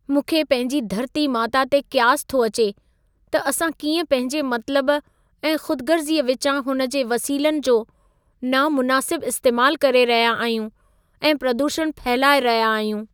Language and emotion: Sindhi, sad